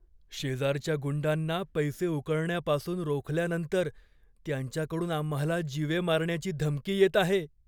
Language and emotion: Marathi, fearful